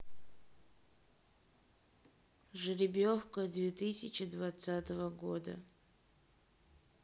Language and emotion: Russian, neutral